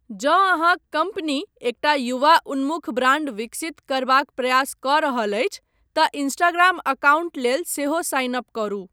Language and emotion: Maithili, neutral